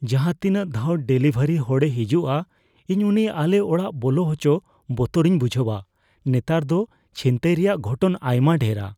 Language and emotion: Santali, fearful